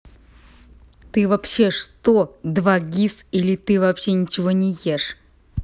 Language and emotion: Russian, angry